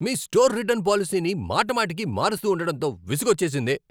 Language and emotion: Telugu, angry